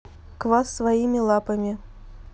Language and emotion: Russian, neutral